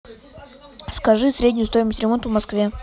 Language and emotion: Russian, neutral